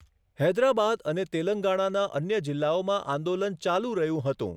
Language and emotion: Gujarati, neutral